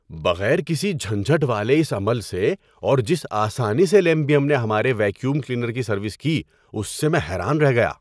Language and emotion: Urdu, surprised